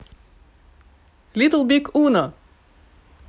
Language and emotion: Russian, positive